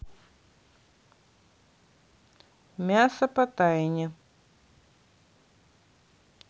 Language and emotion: Russian, neutral